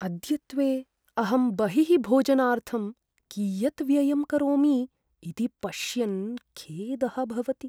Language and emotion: Sanskrit, sad